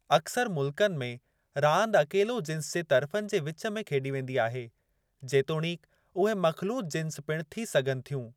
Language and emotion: Sindhi, neutral